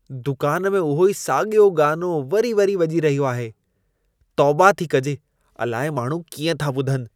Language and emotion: Sindhi, disgusted